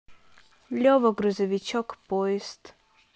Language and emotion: Russian, neutral